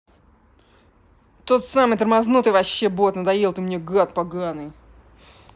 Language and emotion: Russian, angry